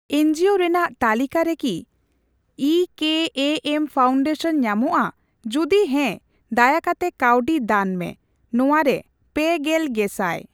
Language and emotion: Santali, neutral